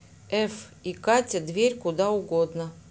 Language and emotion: Russian, neutral